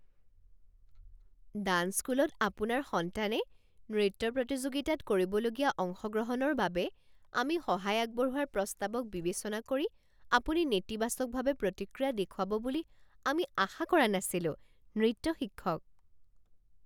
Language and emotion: Assamese, surprised